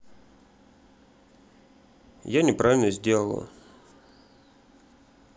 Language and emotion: Russian, sad